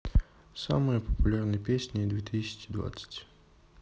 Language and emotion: Russian, neutral